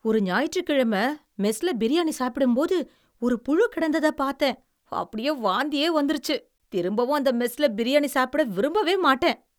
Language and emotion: Tamil, disgusted